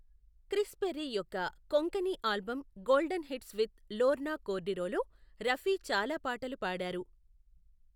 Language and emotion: Telugu, neutral